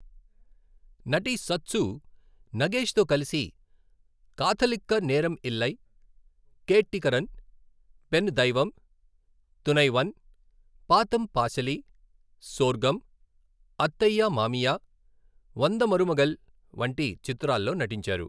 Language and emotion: Telugu, neutral